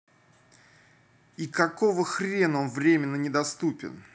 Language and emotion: Russian, angry